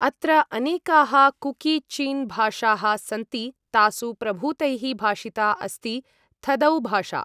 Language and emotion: Sanskrit, neutral